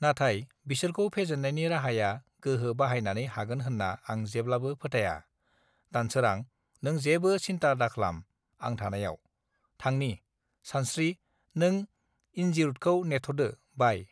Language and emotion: Bodo, neutral